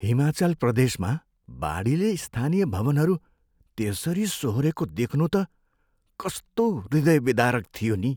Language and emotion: Nepali, sad